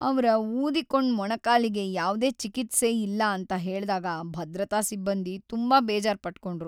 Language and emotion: Kannada, sad